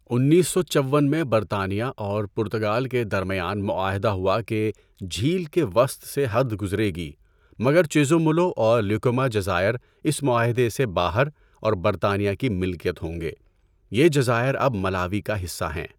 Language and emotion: Urdu, neutral